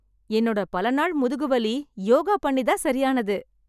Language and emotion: Tamil, happy